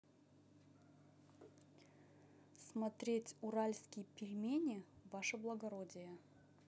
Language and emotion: Russian, neutral